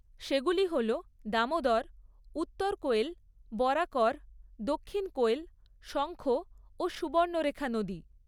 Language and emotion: Bengali, neutral